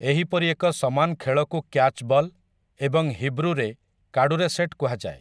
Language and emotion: Odia, neutral